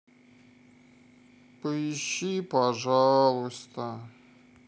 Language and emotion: Russian, sad